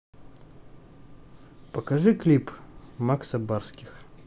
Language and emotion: Russian, neutral